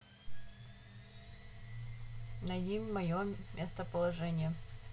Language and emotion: Russian, neutral